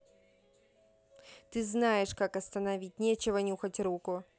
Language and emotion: Russian, angry